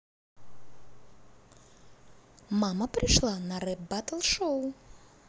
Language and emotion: Russian, neutral